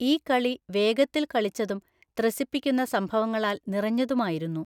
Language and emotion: Malayalam, neutral